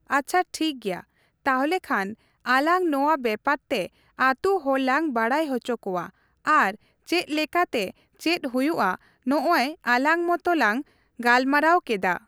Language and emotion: Santali, neutral